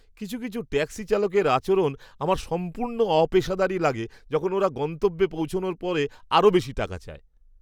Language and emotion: Bengali, disgusted